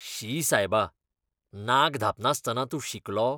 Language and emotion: Goan Konkani, disgusted